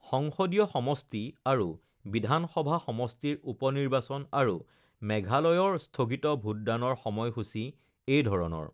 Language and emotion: Assamese, neutral